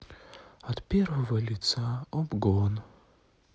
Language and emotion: Russian, sad